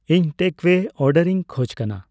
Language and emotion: Santali, neutral